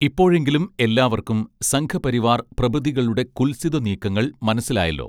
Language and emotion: Malayalam, neutral